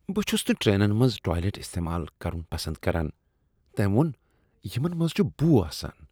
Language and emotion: Kashmiri, disgusted